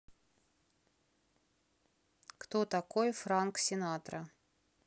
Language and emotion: Russian, neutral